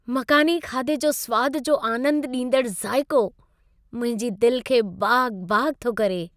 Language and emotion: Sindhi, happy